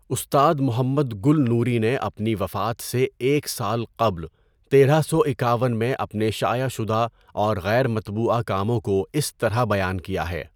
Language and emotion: Urdu, neutral